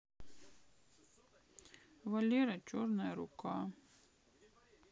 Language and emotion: Russian, sad